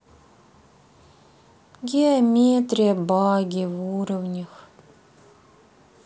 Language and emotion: Russian, sad